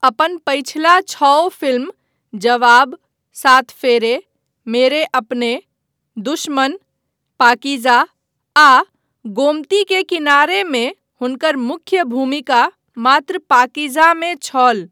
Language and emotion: Maithili, neutral